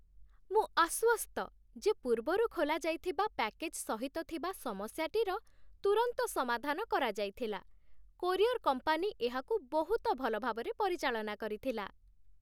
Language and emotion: Odia, happy